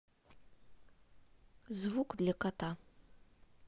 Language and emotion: Russian, neutral